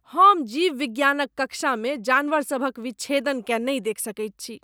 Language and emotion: Maithili, disgusted